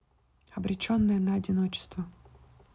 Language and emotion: Russian, neutral